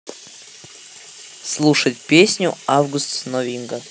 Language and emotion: Russian, neutral